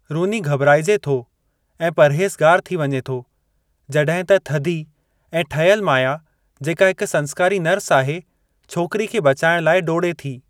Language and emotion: Sindhi, neutral